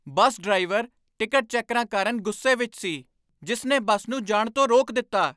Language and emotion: Punjabi, angry